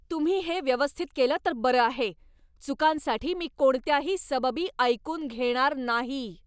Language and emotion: Marathi, angry